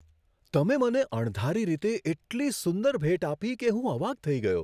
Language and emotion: Gujarati, surprised